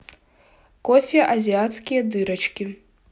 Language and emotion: Russian, neutral